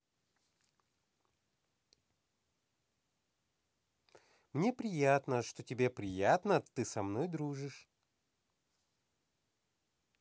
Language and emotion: Russian, positive